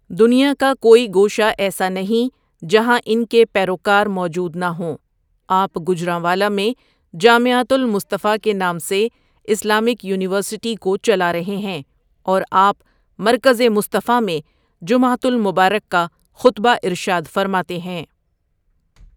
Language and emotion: Urdu, neutral